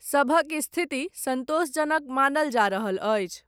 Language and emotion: Maithili, neutral